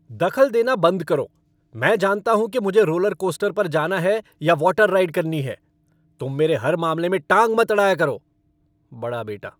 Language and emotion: Hindi, angry